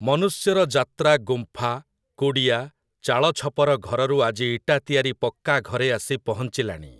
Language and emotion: Odia, neutral